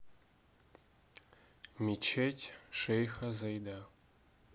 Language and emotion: Russian, neutral